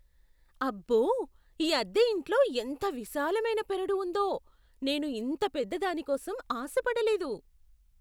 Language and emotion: Telugu, surprised